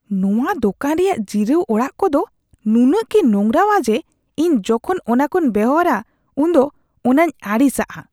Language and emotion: Santali, disgusted